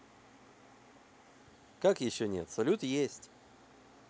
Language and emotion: Russian, positive